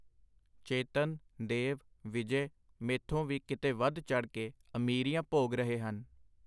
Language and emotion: Punjabi, neutral